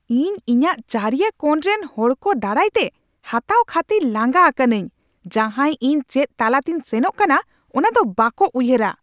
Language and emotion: Santali, angry